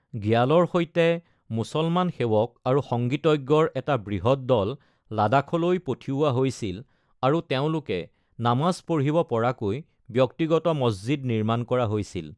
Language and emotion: Assamese, neutral